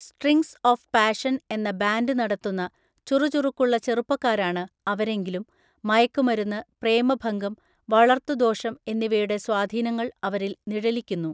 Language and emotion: Malayalam, neutral